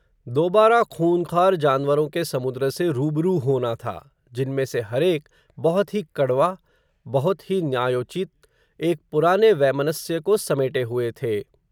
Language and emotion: Hindi, neutral